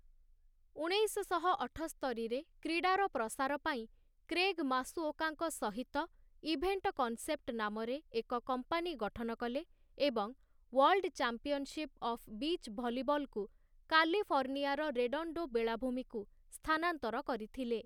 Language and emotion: Odia, neutral